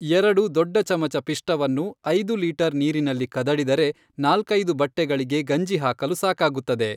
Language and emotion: Kannada, neutral